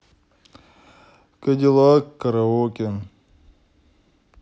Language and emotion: Russian, sad